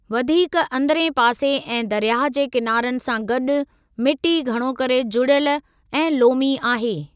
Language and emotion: Sindhi, neutral